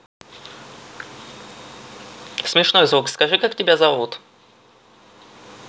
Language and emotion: Russian, neutral